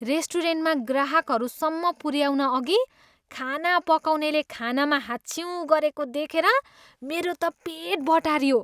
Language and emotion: Nepali, disgusted